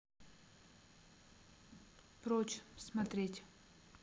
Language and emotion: Russian, neutral